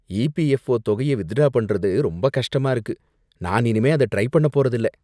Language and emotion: Tamil, disgusted